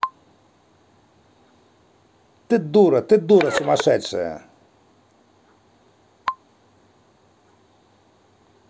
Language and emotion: Russian, angry